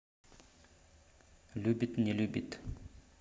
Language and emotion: Russian, neutral